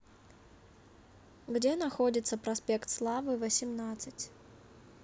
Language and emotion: Russian, neutral